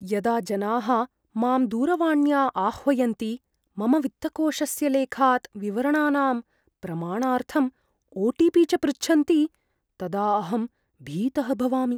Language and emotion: Sanskrit, fearful